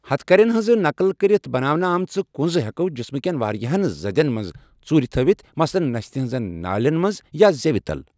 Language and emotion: Kashmiri, neutral